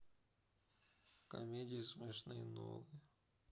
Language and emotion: Russian, sad